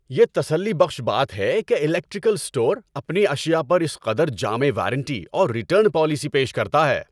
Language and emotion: Urdu, happy